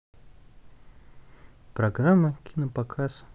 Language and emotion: Russian, neutral